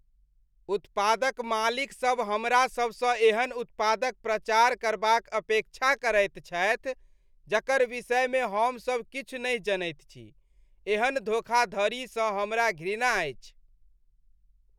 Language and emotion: Maithili, disgusted